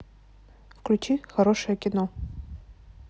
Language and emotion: Russian, neutral